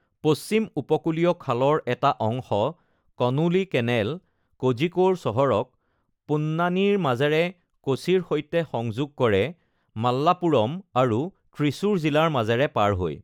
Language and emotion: Assamese, neutral